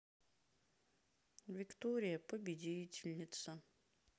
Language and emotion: Russian, sad